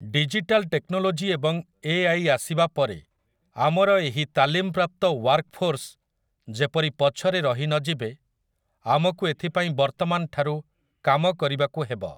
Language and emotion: Odia, neutral